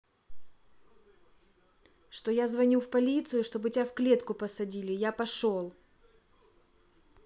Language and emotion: Russian, angry